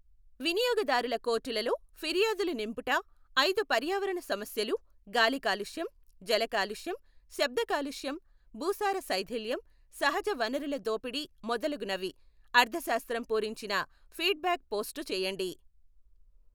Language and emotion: Telugu, neutral